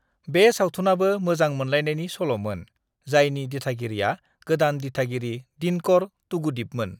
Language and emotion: Bodo, neutral